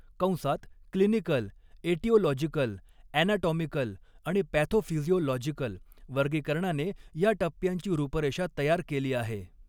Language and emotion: Marathi, neutral